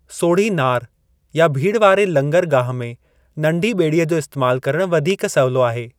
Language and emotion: Sindhi, neutral